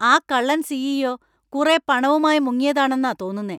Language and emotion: Malayalam, angry